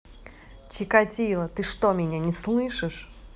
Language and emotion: Russian, angry